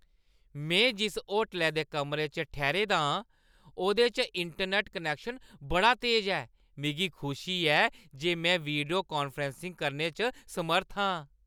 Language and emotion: Dogri, happy